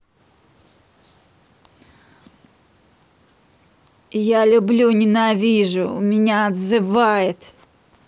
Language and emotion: Russian, angry